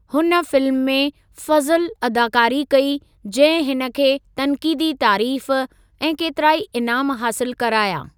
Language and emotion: Sindhi, neutral